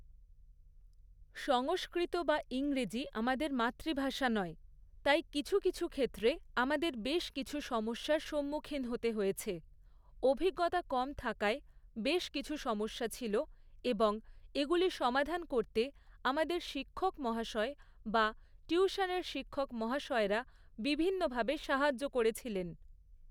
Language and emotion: Bengali, neutral